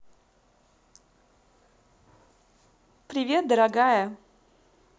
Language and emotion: Russian, positive